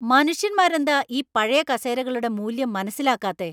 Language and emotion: Malayalam, angry